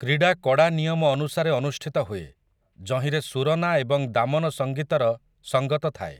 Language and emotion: Odia, neutral